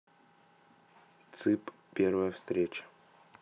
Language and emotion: Russian, neutral